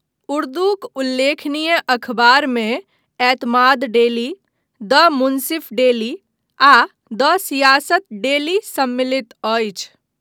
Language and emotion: Maithili, neutral